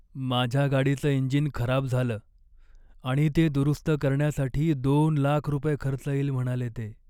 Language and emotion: Marathi, sad